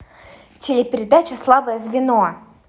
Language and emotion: Russian, neutral